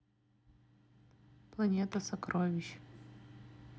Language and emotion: Russian, neutral